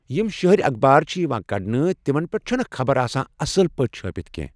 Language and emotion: Kashmiri, neutral